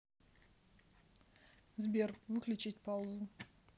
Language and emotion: Russian, neutral